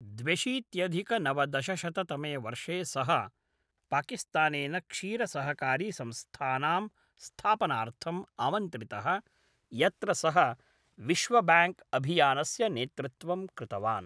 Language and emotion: Sanskrit, neutral